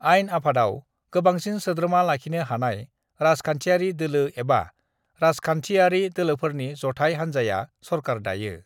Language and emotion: Bodo, neutral